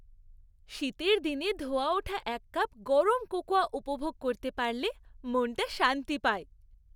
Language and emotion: Bengali, happy